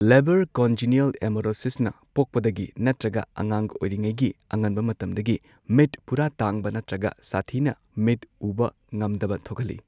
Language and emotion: Manipuri, neutral